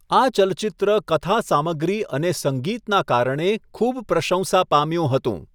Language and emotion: Gujarati, neutral